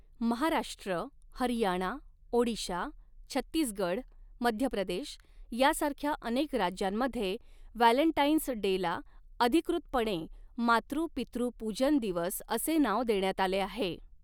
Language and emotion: Marathi, neutral